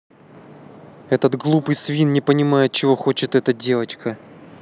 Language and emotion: Russian, angry